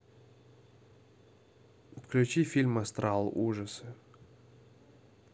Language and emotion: Russian, neutral